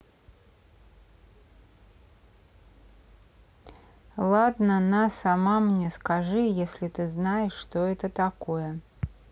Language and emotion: Russian, neutral